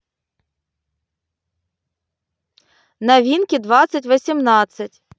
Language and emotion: Russian, neutral